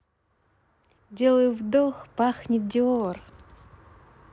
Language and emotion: Russian, positive